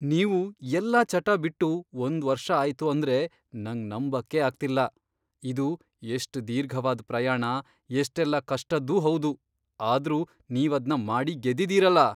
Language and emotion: Kannada, surprised